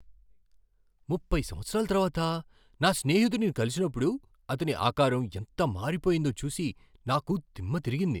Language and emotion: Telugu, surprised